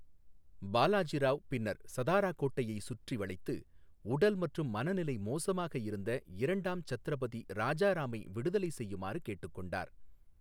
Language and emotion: Tamil, neutral